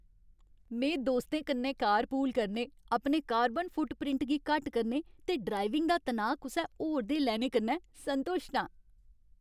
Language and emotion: Dogri, happy